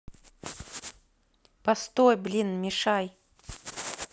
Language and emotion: Russian, neutral